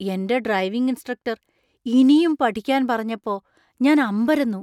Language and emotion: Malayalam, surprised